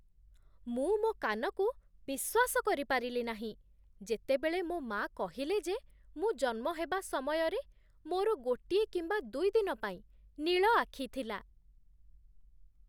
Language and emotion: Odia, surprised